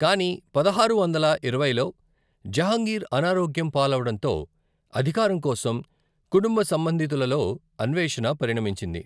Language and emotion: Telugu, neutral